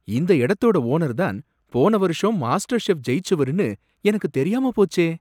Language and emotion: Tamil, surprised